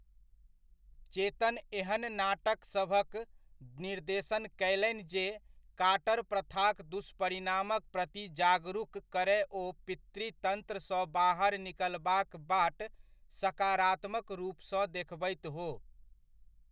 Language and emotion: Maithili, neutral